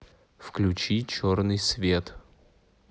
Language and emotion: Russian, neutral